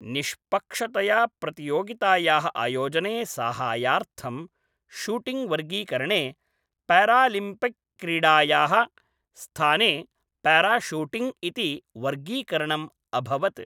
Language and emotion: Sanskrit, neutral